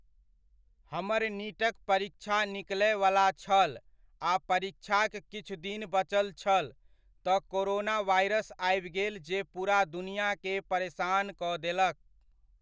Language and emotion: Maithili, neutral